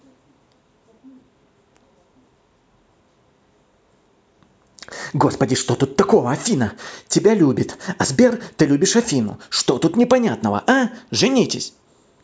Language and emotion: Russian, angry